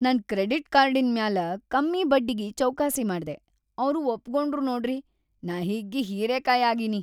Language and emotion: Kannada, happy